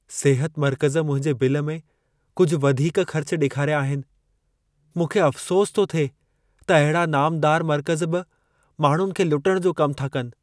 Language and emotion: Sindhi, sad